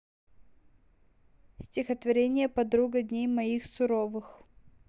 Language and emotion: Russian, neutral